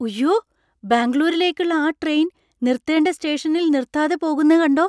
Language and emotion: Malayalam, surprised